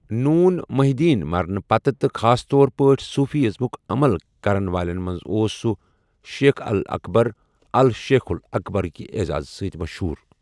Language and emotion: Kashmiri, neutral